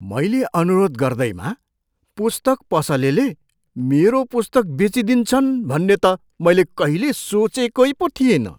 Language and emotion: Nepali, surprised